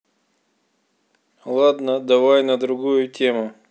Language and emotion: Russian, neutral